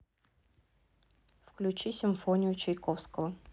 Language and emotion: Russian, neutral